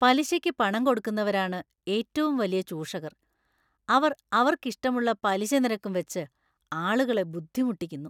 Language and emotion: Malayalam, disgusted